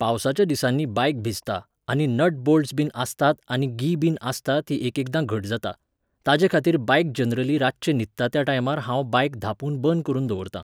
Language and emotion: Goan Konkani, neutral